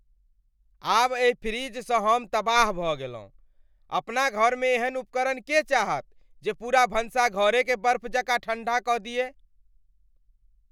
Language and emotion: Maithili, angry